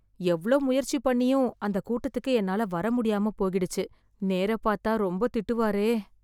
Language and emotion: Tamil, fearful